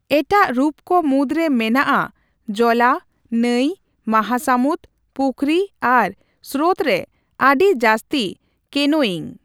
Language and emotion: Santali, neutral